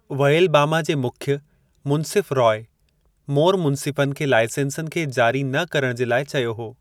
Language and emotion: Sindhi, neutral